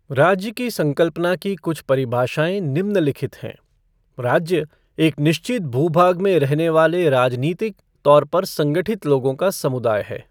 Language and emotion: Hindi, neutral